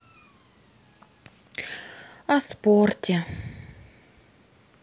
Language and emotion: Russian, sad